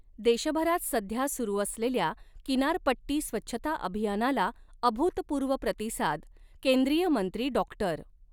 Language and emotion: Marathi, neutral